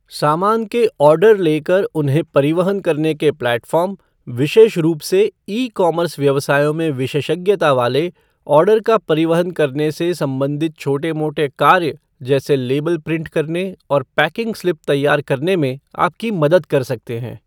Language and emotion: Hindi, neutral